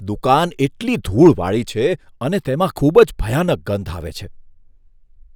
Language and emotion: Gujarati, disgusted